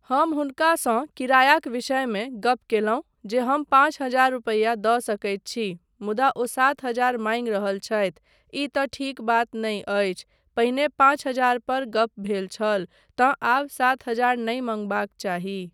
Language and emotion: Maithili, neutral